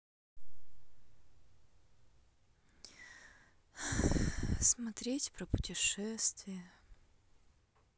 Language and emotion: Russian, sad